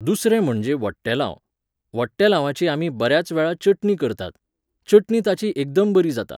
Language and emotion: Goan Konkani, neutral